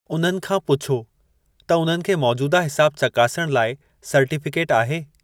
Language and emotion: Sindhi, neutral